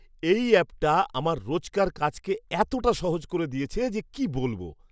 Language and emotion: Bengali, surprised